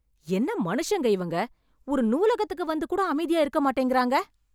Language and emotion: Tamil, angry